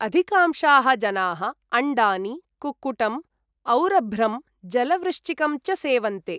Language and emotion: Sanskrit, neutral